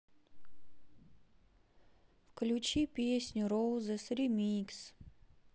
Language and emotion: Russian, sad